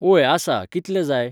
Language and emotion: Goan Konkani, neutral